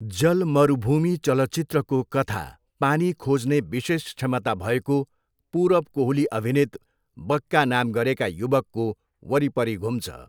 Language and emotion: Nepali, neutral